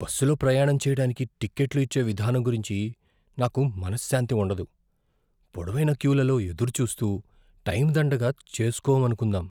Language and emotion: Telugu, fearful